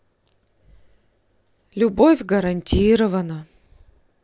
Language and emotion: Russian, sad